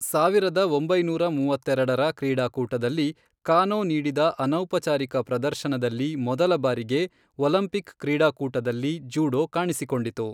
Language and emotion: Kannada, neutral